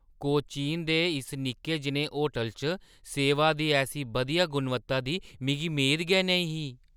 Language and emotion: Dogri, surprised